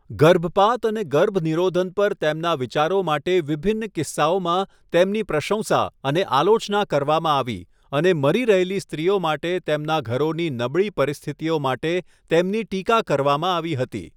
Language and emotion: Gujarati, neutral